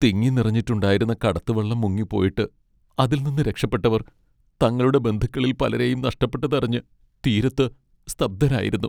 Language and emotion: Malayalam, sad